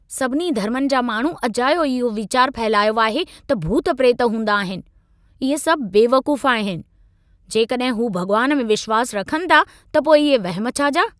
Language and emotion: Sindhi, angry